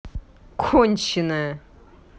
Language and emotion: Russian, angry